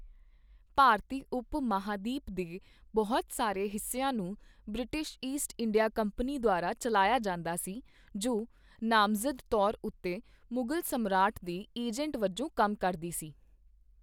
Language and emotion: Punjabi, neutral